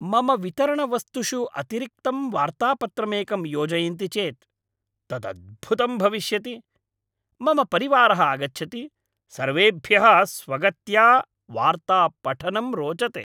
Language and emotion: Sanskrit, happy